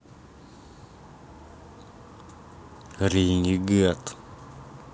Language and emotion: Russian, angry